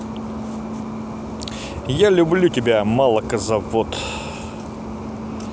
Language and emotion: Russian, positive